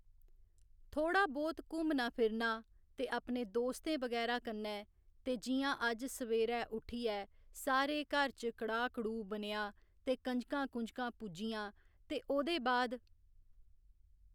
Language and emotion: Dogri, neutral